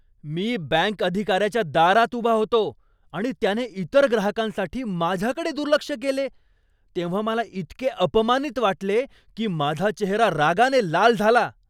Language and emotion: Marathi, angry